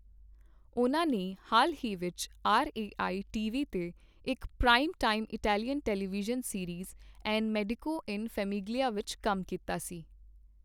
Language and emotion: Punjabi, neutral